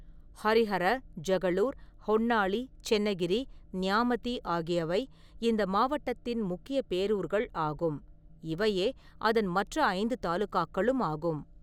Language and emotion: Tamil, neutral